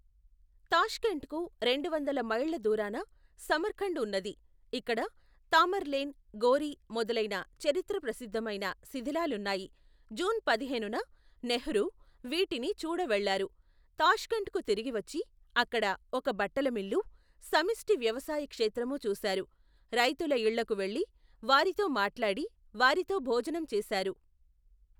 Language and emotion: Telugu, neutral